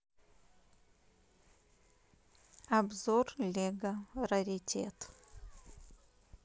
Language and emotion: Russian, neutral